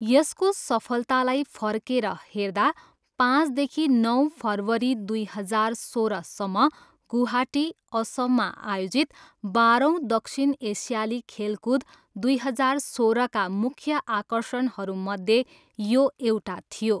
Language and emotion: Nepali, neutral